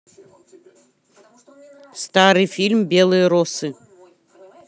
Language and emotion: Russian, neutral